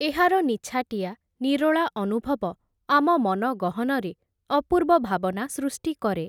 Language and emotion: Odia, neutral